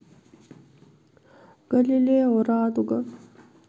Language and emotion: Russian, sad